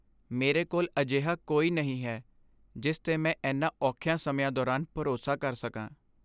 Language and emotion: Punjabi, sad